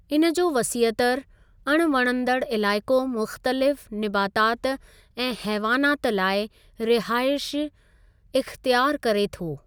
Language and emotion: Sindhi, neutral